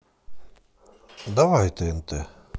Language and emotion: Russian, positive